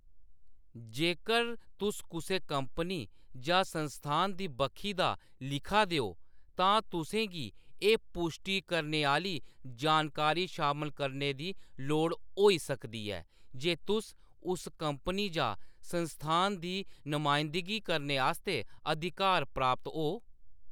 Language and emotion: Dogri, neutral